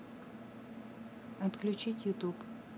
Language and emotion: Russian, neutral